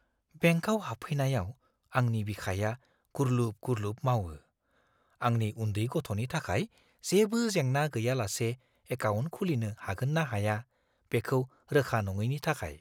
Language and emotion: Bodo, fearful